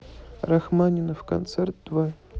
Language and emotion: Russian, neutral